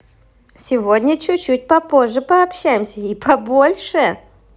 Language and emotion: Russian, positive